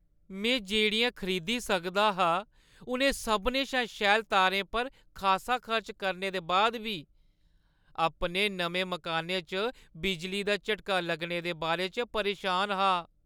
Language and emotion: Dogri, sad